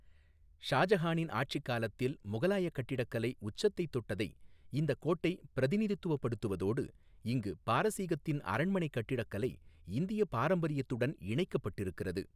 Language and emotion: Tamil, neutral